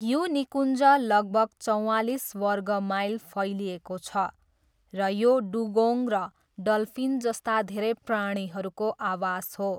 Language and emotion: Nepali, neutral